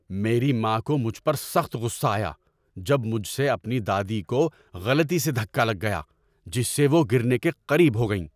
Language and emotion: Urdu, angry